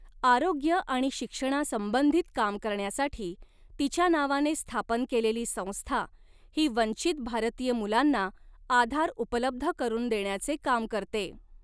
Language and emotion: Marathi, neutral